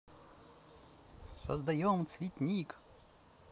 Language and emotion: Russian, positive